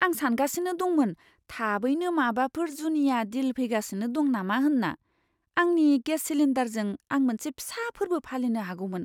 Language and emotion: Bodo, surprised